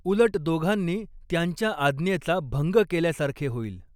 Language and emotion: Marathi, neutral